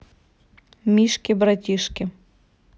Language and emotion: Russian, neutral